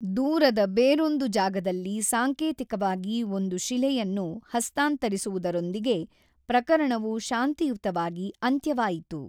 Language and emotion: Kannada, neutral